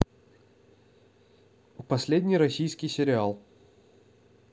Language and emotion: Russian, neutral